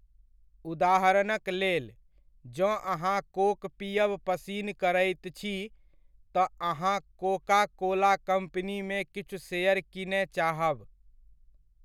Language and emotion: Maithili, neutral